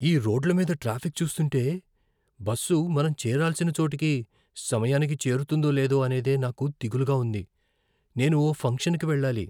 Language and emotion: Telugu, fearful